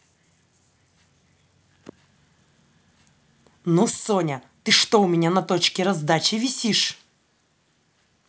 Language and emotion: Russian, angry